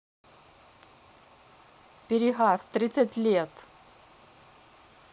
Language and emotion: Russian, neutral